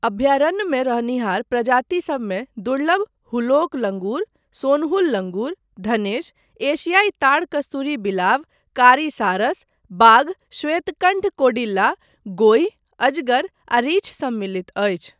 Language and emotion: Maithili, neutral